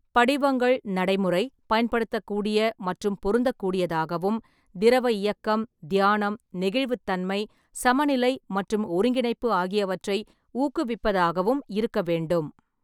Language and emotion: Tamil, neutral